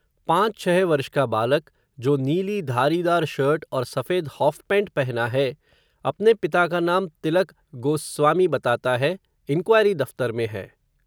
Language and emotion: Hindi, neutral